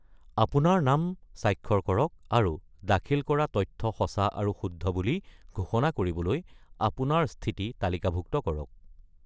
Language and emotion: Assamese, neutral